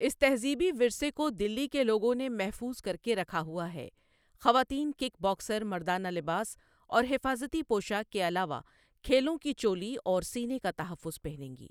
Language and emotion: Urdu, neutral